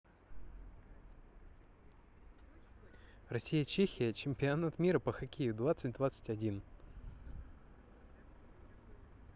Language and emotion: Russian, neutral